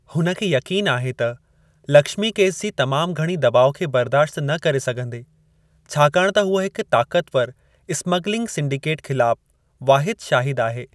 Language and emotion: Sindhi, neutral